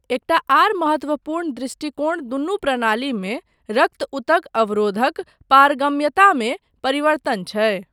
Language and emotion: Maithili, neutral